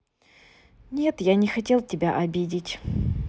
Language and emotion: Russian, neutral